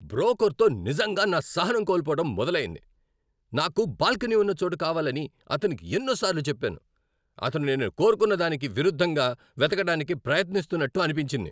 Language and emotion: Telugu, angry